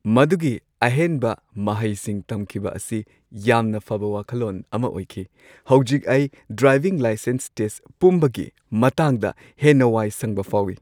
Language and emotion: Manipuri, happy